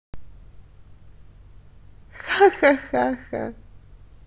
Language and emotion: Russian, positive